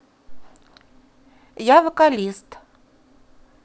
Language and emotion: Russian, neutral